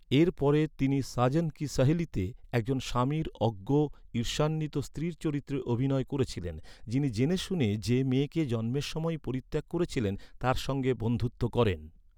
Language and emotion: Bengali, neutral